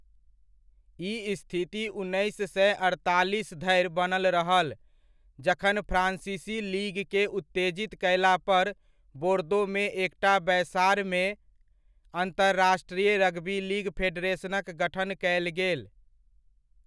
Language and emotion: Maithili, neutral